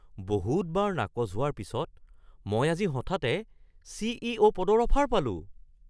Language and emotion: Assamese, surprised